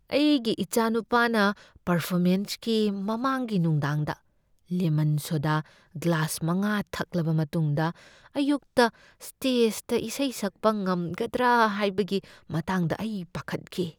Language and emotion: Manipuri, fearful